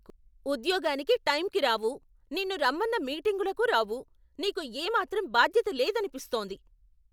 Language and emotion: Telugu, angry